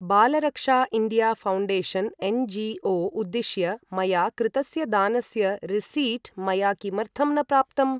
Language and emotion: Sanskrit, neutral